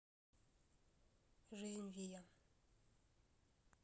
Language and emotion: Russian, neutral